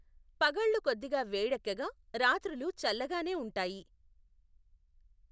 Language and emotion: Telugu, neutral